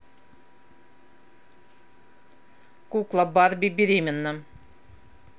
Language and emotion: Russian, angry